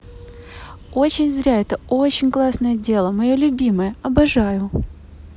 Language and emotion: Russian, neutral